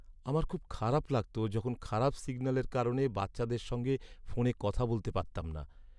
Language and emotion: Bengali, sad